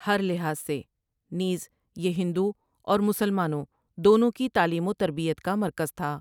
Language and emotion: Urdu, neutral